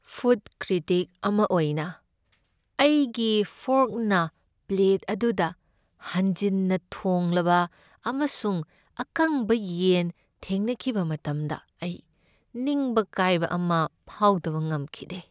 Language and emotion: Manipuri, sad